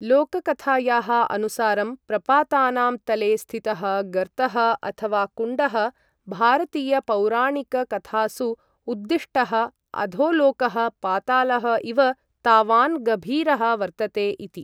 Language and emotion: Sanskrit, neutral